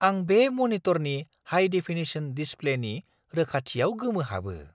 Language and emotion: Bodo, surprised